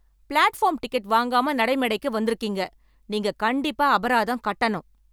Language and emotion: Tamil, angry